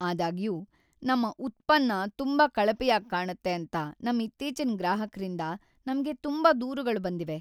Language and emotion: Kannada, sad